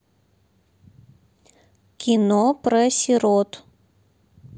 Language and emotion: Russian, neutral